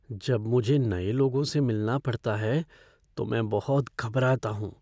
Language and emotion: Hindi, fearful